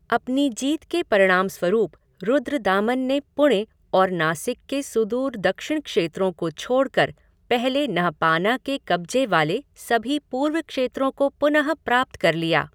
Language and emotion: Hindi, neutral